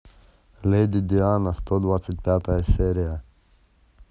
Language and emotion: Russian, neutral